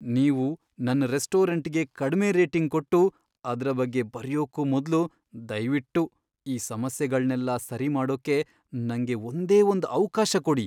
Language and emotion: Kannada, fearful